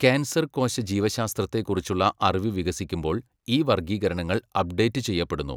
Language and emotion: Malayalam, neutral